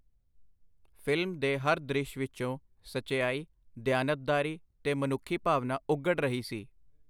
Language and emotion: Punjabi, neutral